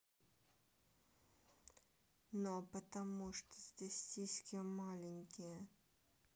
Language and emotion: Russian, neutral